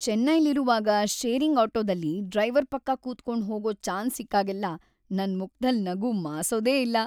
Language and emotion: Kannada, happy